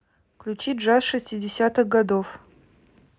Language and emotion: Russian, neutral